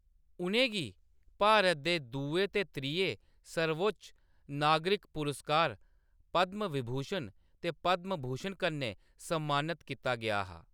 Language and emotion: Dogri, neutral